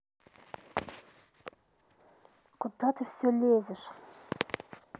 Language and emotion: Russian, angry